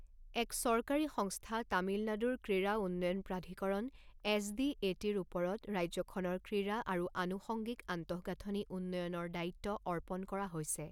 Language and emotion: Assamese, neutral